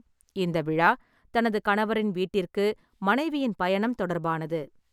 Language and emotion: Tamil, neutral